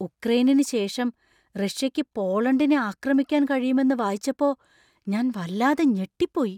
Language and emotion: Malayalam, surprised